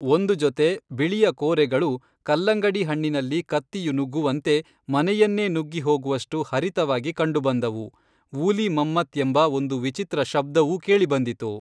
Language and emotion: Kannada, neutral